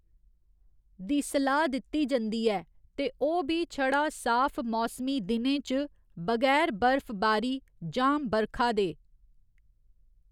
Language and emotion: Dogri, neutral